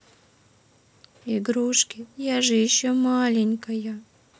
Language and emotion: Russian, sad